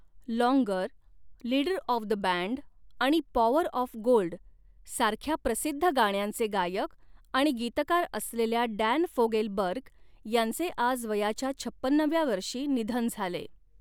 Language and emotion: Marathi, neutral